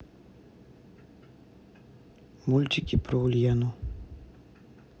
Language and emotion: Russian, neutral